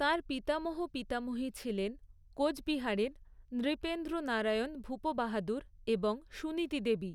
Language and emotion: Bengali, neutral